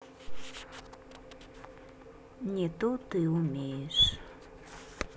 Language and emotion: Russian, sad